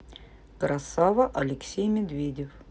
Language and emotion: Russian, neutral